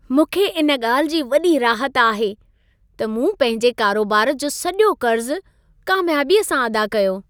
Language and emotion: Sindhi, happy